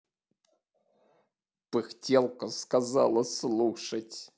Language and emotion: Russian, angry